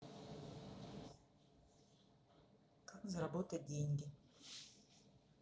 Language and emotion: Russian, neutral